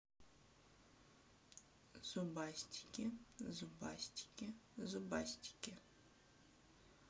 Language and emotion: Russian, neutral